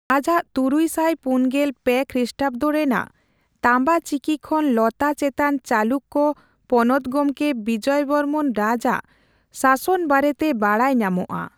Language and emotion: Santali, neutral